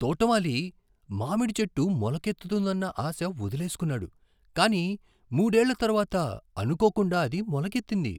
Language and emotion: Telugu, surprised